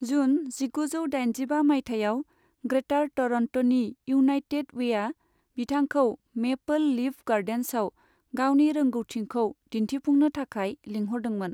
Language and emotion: Bodo, neutral